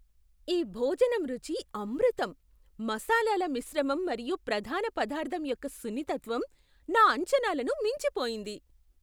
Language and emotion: Telugu, surprised